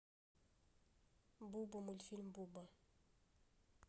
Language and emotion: Russian, neutral